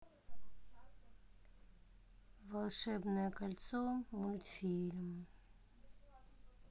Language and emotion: Russian, sad